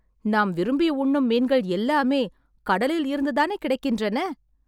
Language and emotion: Tamil, happy